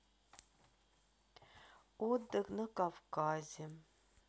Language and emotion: Russian, sad